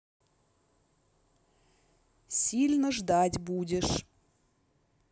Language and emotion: Russian, neutral